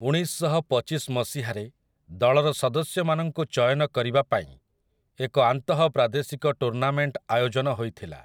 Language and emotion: Odia, neutral